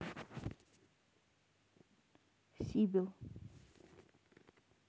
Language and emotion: Russian, neutral